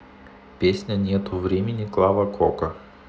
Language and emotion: Russian, neutral